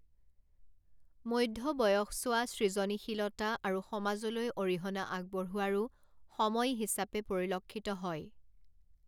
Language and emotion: Assamese, neutral